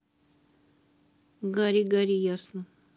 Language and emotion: Russian, neutral